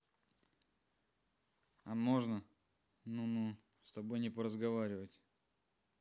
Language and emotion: Russian, neutral